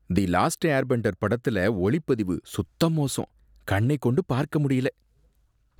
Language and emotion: Tamil, disgusted